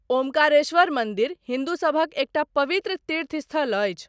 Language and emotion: Maithili, neutral